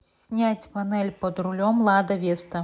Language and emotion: Russian, neutral